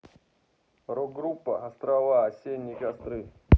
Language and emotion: Russian, neutral